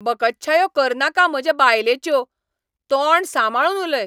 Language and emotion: Goan Konkani, angry